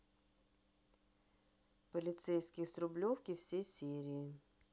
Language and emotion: Russian, neutral